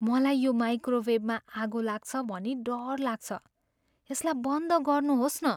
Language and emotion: Nepali, fearful